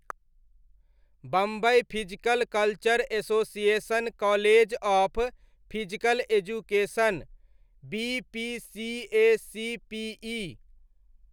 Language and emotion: Maithili, neutral